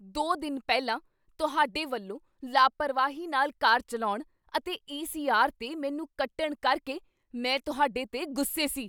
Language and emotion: Punjabi, angry